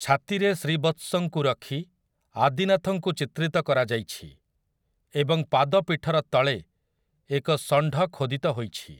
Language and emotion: Odia, neutral